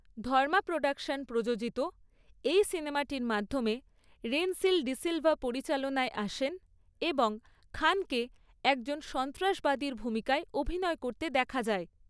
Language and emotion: Bengali, neutral